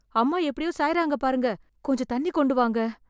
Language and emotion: Tamil, fearful